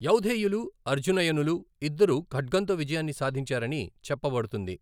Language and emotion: Telugu, neutral